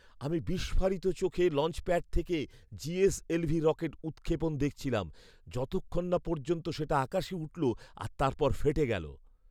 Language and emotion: Bengali, surprised